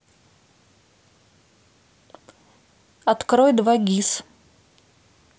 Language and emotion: Russian, neutral